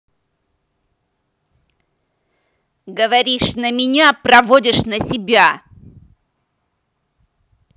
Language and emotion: Russian, angry